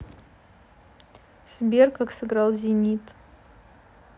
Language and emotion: Russian, neutral